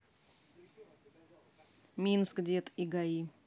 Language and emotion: Russian, neutral